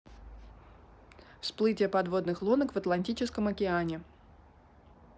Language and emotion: Russian, neutral